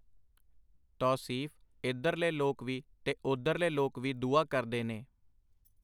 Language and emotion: Punjabi, neutral